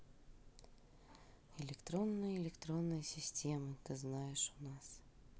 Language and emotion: Russian, neutral